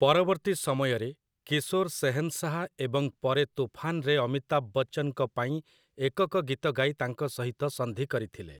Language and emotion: Odia, neutral